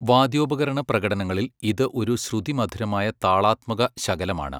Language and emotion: Malayalam, neutral